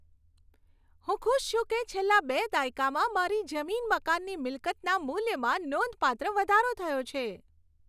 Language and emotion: Gujarati, happy